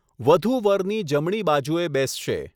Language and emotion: Gujarati, neutral